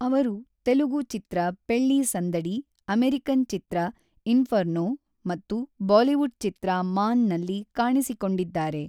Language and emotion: Kannada, neutral